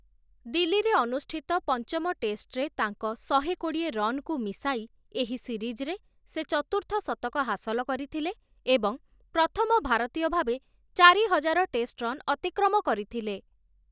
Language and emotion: Odia, neutral